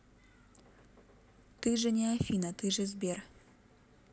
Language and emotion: Russian, neutral